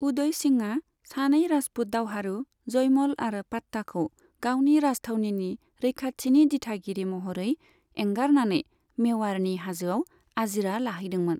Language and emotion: Bodo, neutral